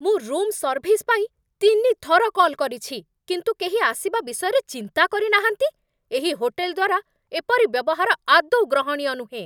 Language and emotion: Odia, angry